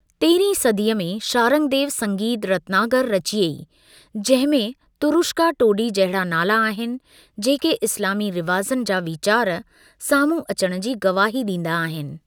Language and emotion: Sindhi, neutral